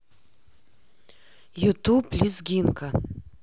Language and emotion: Russian, neutral